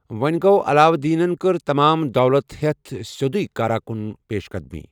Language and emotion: Kashmiri, neutral